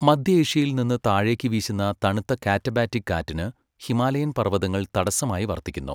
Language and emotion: Malayalam, neutral